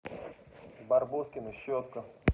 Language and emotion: Russian, neutral